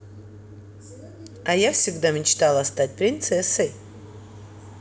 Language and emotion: Russian, positive